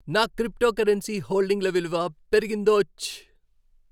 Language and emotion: Telugu, happy